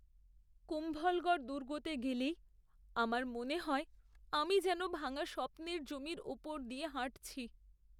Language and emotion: Bengali, sad